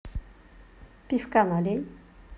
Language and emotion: Russian, positive